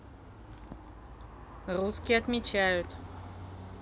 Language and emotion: Russian, neutral